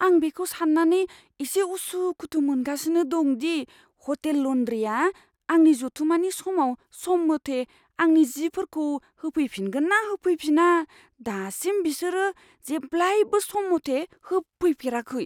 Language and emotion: Bodo, fearful